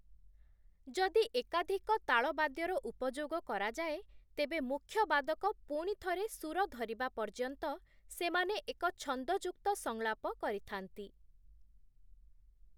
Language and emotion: Odia, neutral